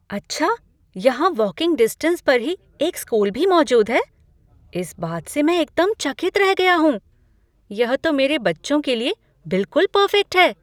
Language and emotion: Hindi, surprised